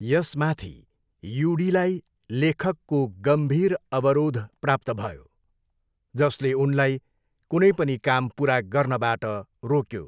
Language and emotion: Nepali, neutral